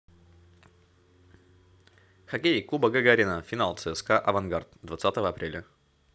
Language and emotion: Russian, neutral